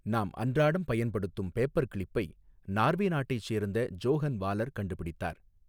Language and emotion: Tamil, neutral